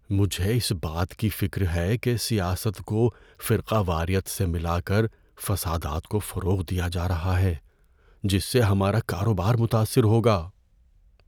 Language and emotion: Urdu, fearful